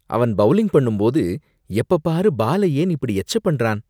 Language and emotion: Tamil, disgusted